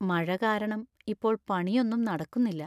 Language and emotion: Malayalam, sad